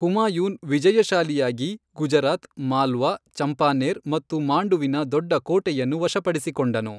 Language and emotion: Kannada, neutral